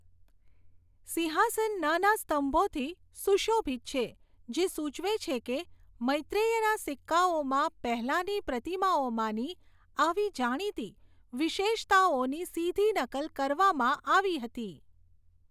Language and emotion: Gujarati, neutral